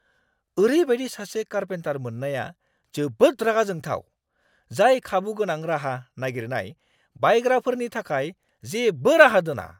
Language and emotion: Bodo, angry